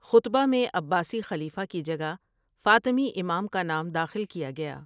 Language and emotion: Urdu, neutral